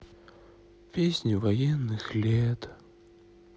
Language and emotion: Russian, sad